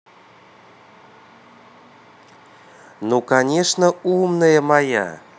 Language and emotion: Russian, positive